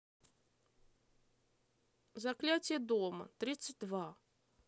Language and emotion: Russian, neutral